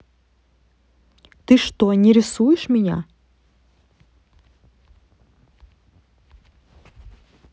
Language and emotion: Russian, neutral